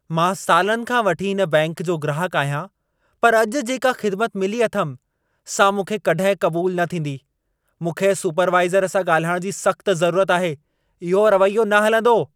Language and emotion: Sindhi, angry